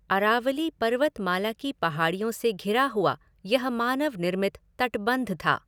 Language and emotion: Hindi, neutral